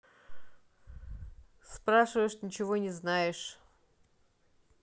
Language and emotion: Russian, neutral